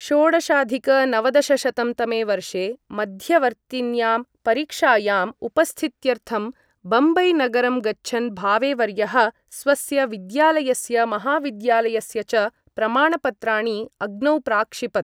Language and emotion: Sanskrit, neutral